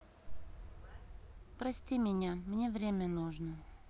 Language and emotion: Russian, sad